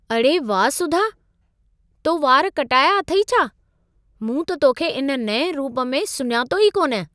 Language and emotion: Sindhi, surprised